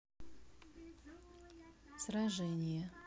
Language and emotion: Russian, neutral